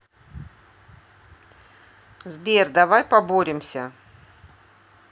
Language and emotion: Russian, neutral